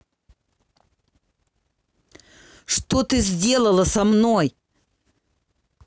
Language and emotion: Russian, angry